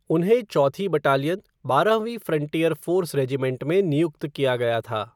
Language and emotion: Hindi, neutral